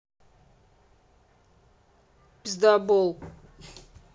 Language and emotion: Russian, angry